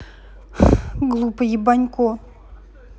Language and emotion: Russian, angry